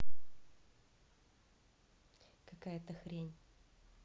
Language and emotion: Russian, neutral